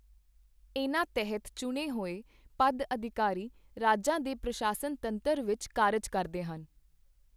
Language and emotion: Punjabi, neutral